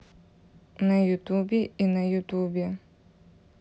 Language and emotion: Russian, neutral